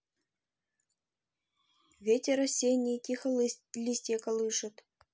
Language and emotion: Russian, neutral